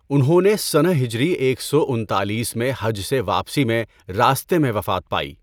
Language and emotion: Urdu, neutral